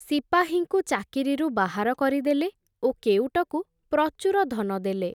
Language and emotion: Odia, neutral